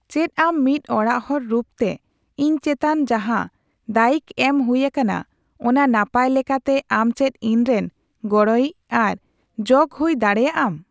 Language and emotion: Santali, neutral